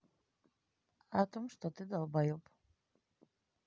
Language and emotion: Russian, neutral